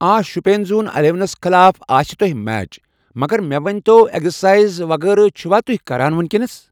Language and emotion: Kashmiri, neutral